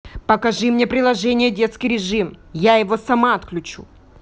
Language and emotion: Russian, angry